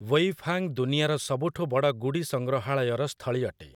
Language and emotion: Odia, neutral